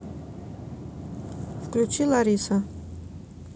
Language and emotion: Russian, neutral